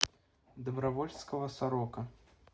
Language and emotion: Russian, neutral